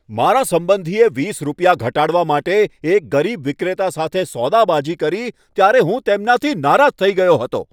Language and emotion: Gujarati, angry